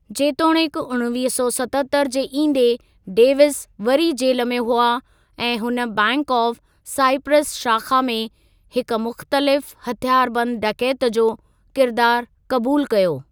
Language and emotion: Sindhi, neutral